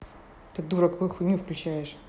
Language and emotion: Russian, angry